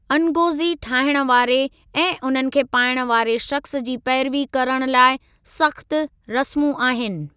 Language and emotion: Sindhi, neutral